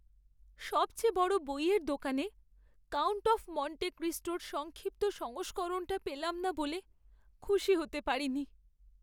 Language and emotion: Bengali, sad